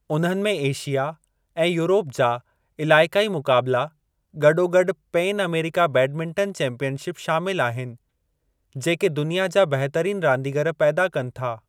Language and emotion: Sindhi, neutral